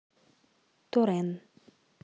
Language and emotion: Russian, neutral